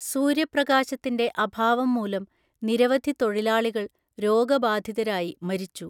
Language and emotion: Malayalam, neutral